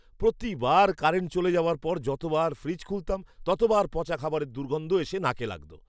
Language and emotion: Bengali, disgusted